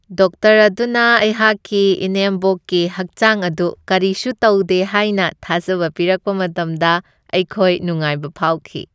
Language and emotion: Manipuri, happy